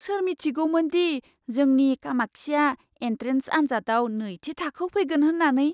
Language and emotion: Bodo, surprised